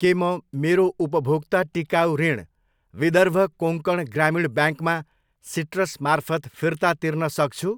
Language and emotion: Nepali, neutral